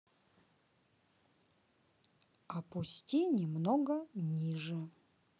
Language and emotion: Russian, neutral